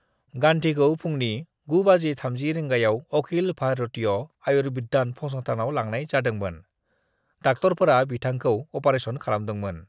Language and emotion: Bodo, neutral